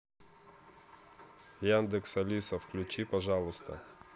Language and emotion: Russian, neutral